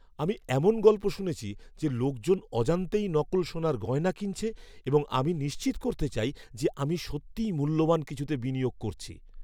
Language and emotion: Bengali, fearful